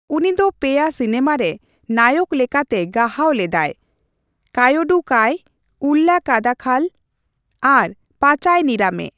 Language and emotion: Santali, neutral